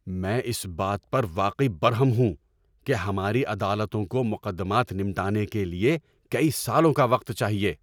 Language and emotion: Urdu, angry